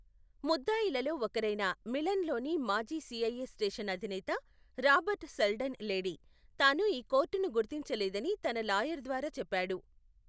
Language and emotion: Telugu, neutral